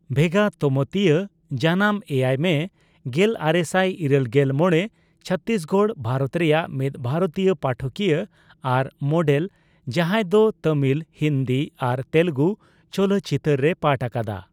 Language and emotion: Santali, neutral